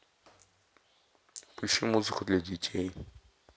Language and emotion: Russian, neutral